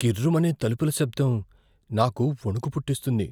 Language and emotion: Telugu, fearful